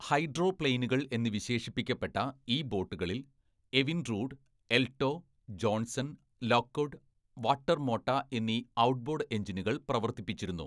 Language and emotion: Malayalam, neutral